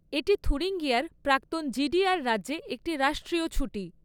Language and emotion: Bengali, neutral